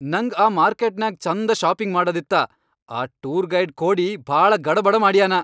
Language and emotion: Kannada, angry